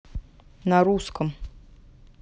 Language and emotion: Russian, neutral